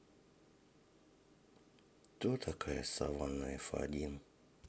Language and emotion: Russian, sad